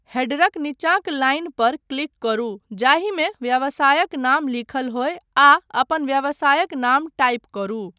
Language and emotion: Maithili, neutral